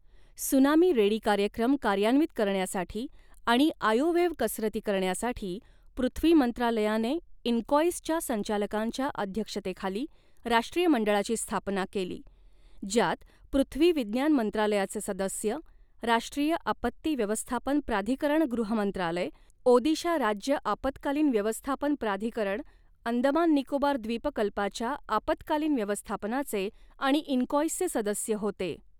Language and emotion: Marathi, neutral